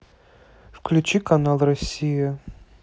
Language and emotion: Russian, neutral